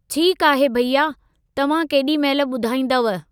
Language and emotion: Sindhi, neutral